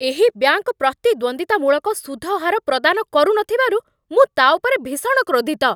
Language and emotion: Odia, angry